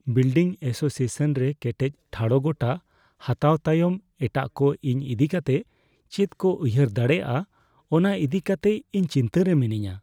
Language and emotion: Santali, fearful